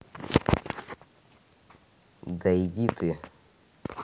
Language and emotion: Russian, neutral